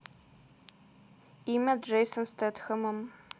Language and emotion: Russian, neutral